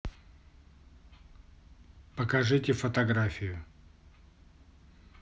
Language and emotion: Russian, neutral